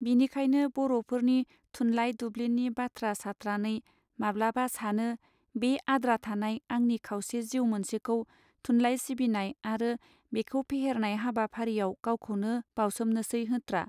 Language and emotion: Bodo, neutral